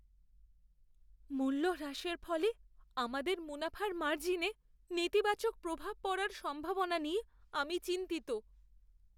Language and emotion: Bengali, fearful